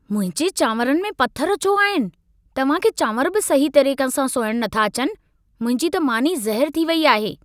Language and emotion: Sindhi, angry